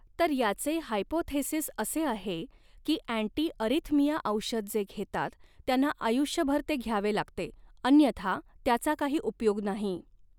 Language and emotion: Marathi, neutral